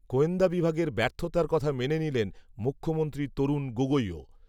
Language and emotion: Bengali, neutral